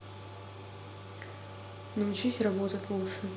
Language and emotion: Russian, neutral